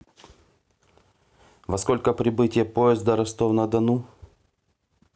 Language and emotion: Russian, neutral